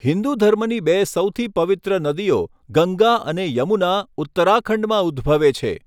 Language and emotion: Gujarati, neutral